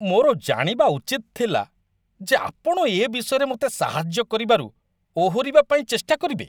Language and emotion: Odia, disgusted